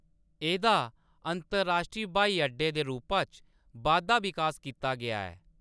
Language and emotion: Dogri, neutral